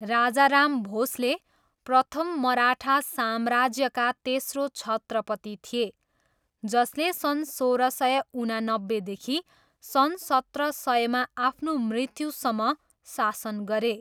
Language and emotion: Nepali, neutral